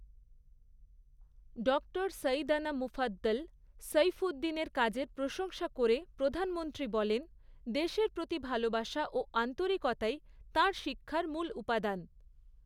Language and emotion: Bengali, neutral